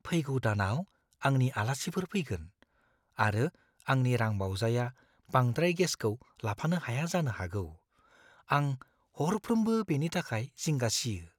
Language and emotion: Bodo, fearful